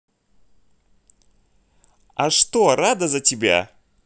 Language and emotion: Russian, positive